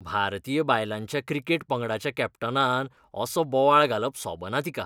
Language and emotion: Goan Konkani, disgusted